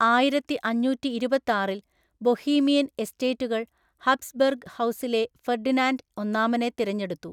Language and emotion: Malayalam, neutral